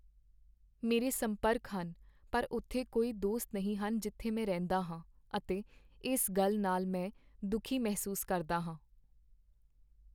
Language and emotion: Punjabi, sad